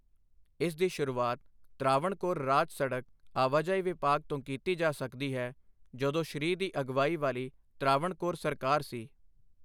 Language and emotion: Punjabi, neutral